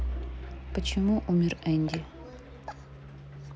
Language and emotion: Russian, neutral